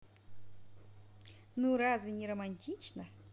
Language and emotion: Russian, positive